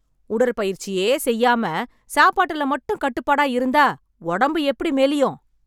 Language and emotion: Tamil, angry